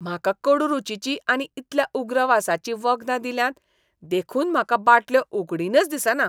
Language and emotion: Goan Konkani, disgusted